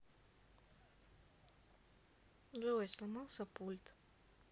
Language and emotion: Russian, sad